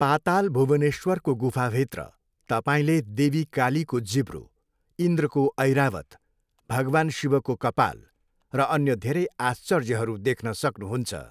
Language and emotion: Nepali, neutral